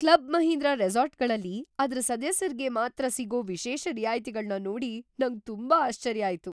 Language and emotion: Kannada, surprised